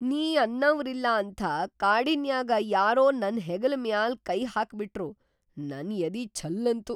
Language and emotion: Kannada, surprised